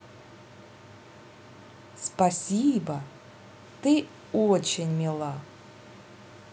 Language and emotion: Russian, positive